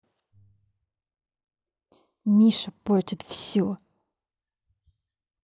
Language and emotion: Russian, angry